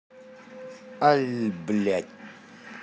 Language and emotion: Russian, angry